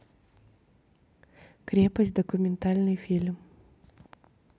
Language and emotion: Russian, neutral